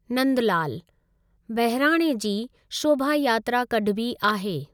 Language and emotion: Sindhi, neutral